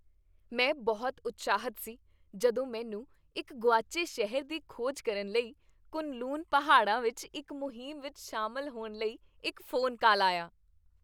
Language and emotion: Punjabi, happy